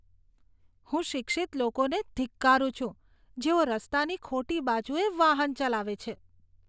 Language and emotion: Gujarati, disgusted